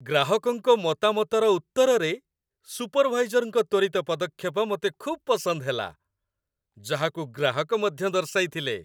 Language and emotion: Odia, happy